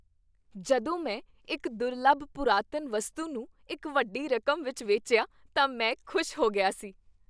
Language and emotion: Punjabi, happy